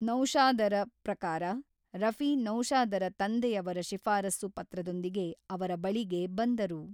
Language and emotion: Kannada, neutral